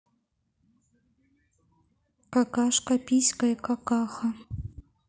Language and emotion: Russian, neutral